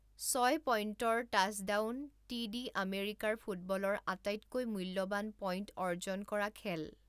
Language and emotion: Assamese, neutral